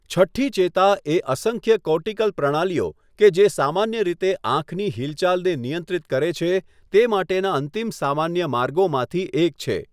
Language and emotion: Gujarati, neutral